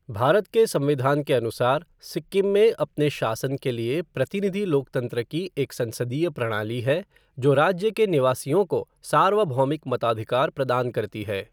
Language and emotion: Hindi, neutral